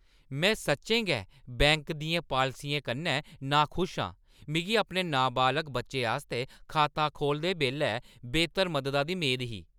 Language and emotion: Dogri, angry